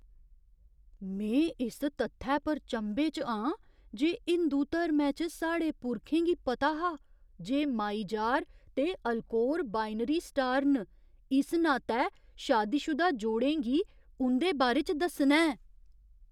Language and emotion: Dogri, surprised